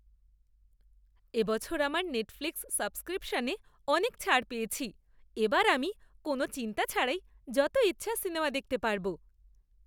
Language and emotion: Bengali, happy